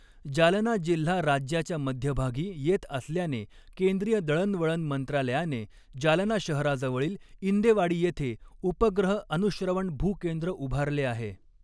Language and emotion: Marathi, neutral